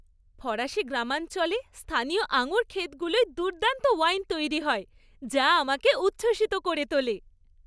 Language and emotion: Bengali, happy